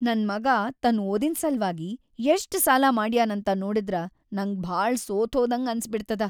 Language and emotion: Kannada, sad